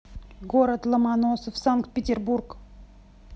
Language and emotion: Russian, neutral